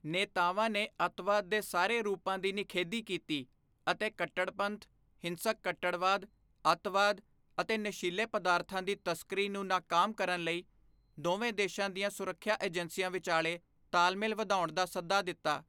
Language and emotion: Punjabi, neutral